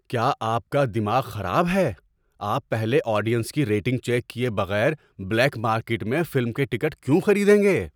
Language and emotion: Urdu, surprised